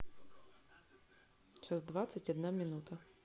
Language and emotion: Russian, neutral